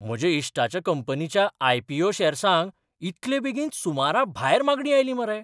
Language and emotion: Goan Konkani, surprised